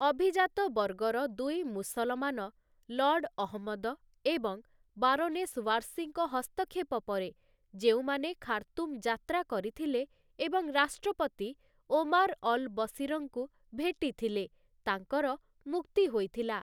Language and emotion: Odia, neutral